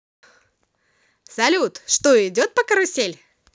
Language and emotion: Russian, positive